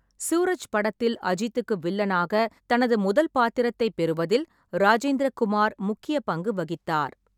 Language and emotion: Tamil, neutral